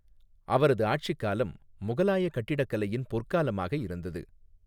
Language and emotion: Tamil, neutral